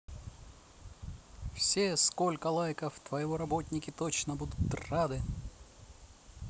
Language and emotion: Russian, positive